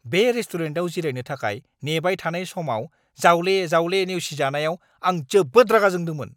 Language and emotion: Bodo, angry